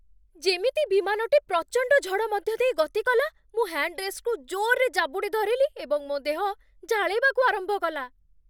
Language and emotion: Odia, fearful